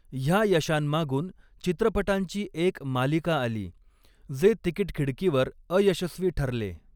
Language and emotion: Marathi, neutral